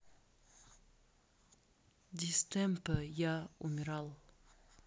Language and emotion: Russian, sad